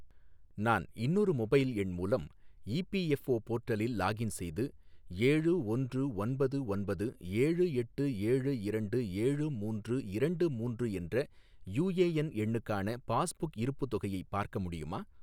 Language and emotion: Tamil, neutral